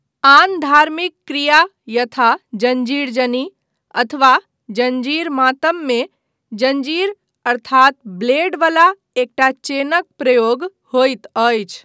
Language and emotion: Maithili, neutral